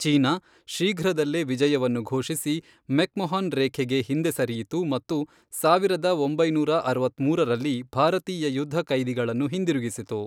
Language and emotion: Kannada, neutral